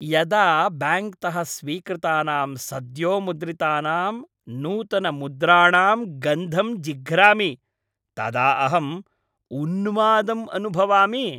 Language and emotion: Sanskrit, happy